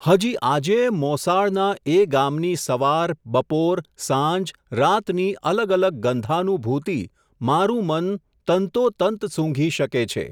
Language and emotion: Gujarati, neutral